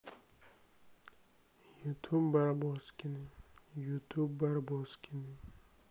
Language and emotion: Russian, sad